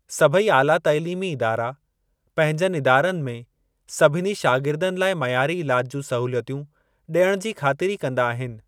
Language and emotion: Sindhi, neutral